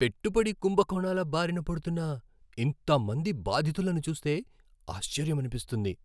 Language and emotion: Telugu, surprised